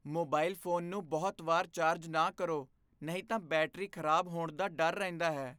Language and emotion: Punjabi, fearful